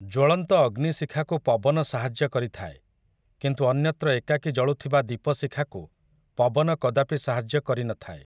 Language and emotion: Odia, neutral